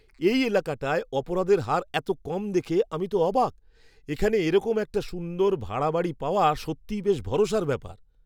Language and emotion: Bengali, surprised